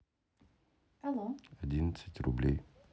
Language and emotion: Russian, neutral